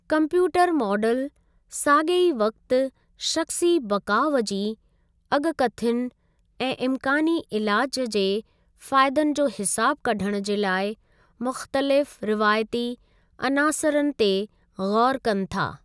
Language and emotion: Sindhi, neutral